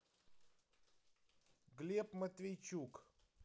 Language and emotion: Russian, neutral